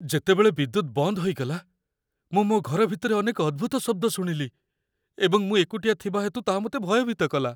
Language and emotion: Odia, fearful